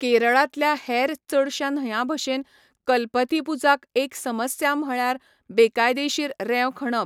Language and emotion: Goan Konkani, neutral